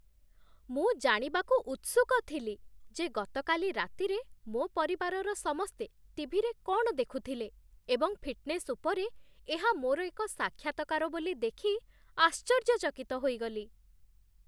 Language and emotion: Odia, surprised